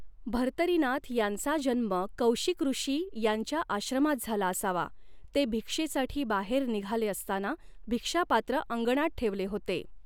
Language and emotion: Marathi, neutral